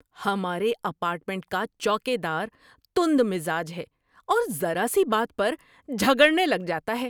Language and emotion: Urdu, angry